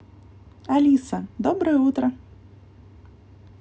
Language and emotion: Russian, positive